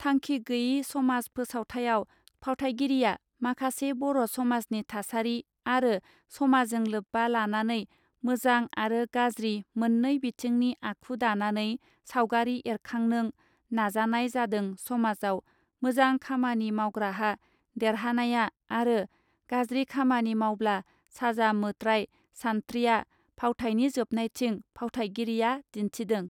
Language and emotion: Bodo, neutral